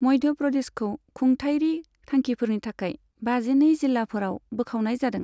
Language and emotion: Bodo, neutral